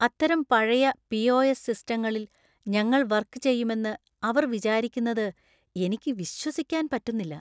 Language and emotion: Malayalam, disgusted